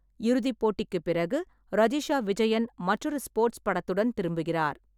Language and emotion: Tamil, neutral